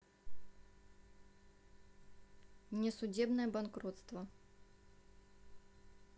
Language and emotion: Russian, neutral